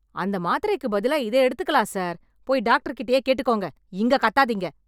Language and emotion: Tamil, angry